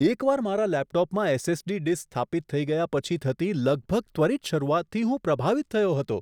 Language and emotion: Gujarati, surprised